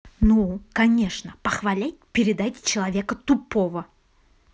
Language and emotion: Russian, angry